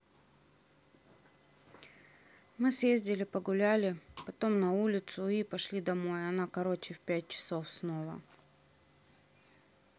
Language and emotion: Russian, neutral